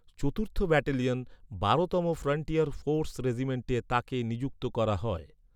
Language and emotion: Bengali, neutral